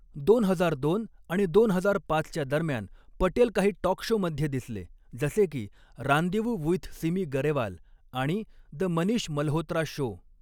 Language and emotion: Marathi, neutral